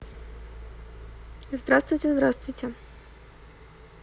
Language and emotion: Russian, neutral